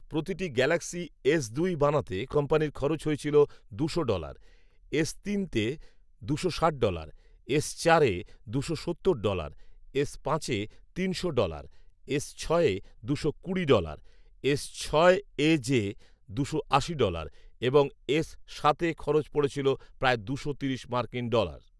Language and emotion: Bengali, neutral